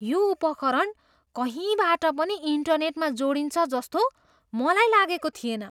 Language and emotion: Nepali, surprised